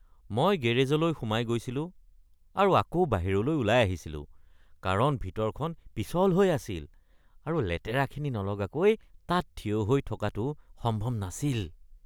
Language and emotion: Assamese, disgusted